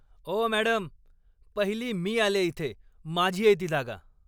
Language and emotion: Marathi, angry